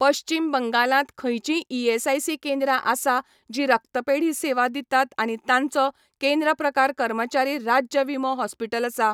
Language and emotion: Goan Konkani, neutral